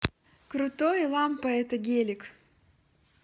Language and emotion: Russian, positive